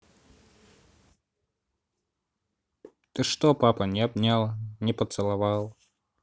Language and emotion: Russian, neutral